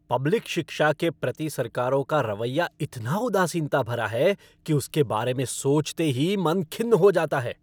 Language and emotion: Hindi, angry